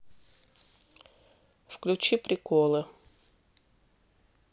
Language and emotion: Russian, neutral